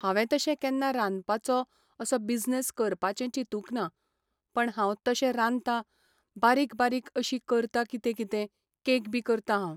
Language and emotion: Goan Konkani, neutral